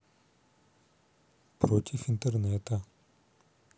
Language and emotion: Russian, neutral